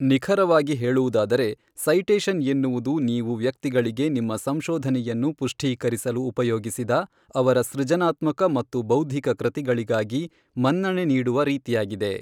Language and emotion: Kannada, neutral